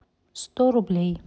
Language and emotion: Russian, neutral